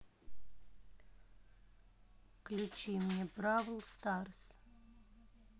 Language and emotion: Russian, neutral